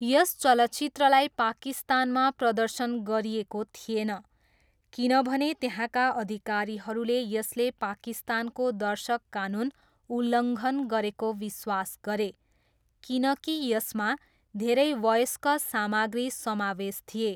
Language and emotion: Nepali, neutral